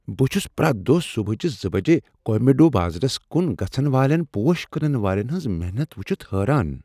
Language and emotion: Kashmiri, surprised